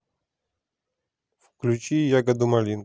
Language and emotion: Russian, neutral